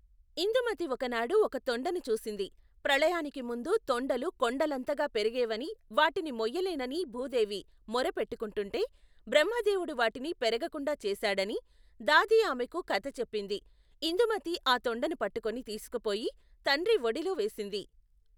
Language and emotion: Telugu, neutral